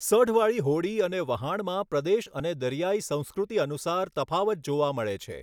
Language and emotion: Gujarati, neutral